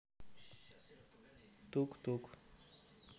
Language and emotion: Russian, neutral